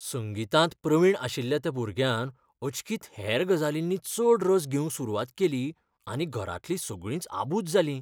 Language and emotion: Goan Konkani, fearful